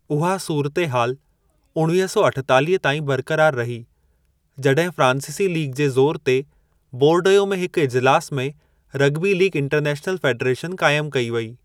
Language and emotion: Sindhi, neutral